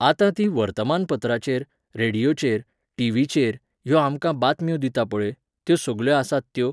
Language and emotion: Goan Konkani, neutral